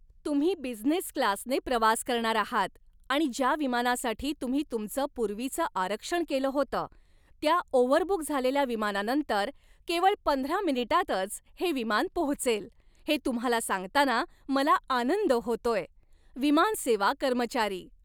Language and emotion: Marathi, happy